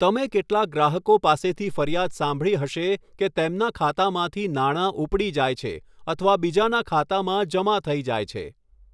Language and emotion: Gujarati, neutral